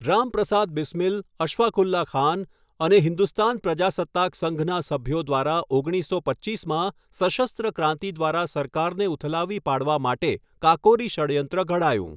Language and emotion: Gujarati, neutral